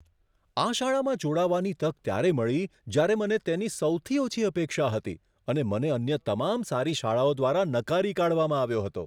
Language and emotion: Gujarati, surprised